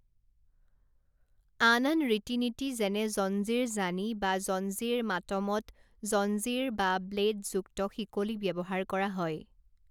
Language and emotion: Assamese, neutral